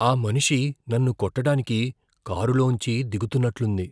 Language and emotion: Telugu, fearful